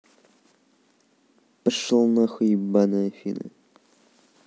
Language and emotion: Russian, angry